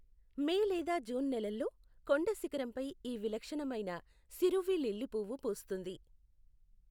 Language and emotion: Telugu, neutral